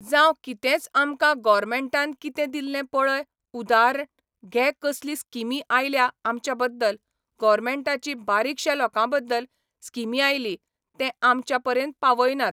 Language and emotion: Goan Konkani, neutral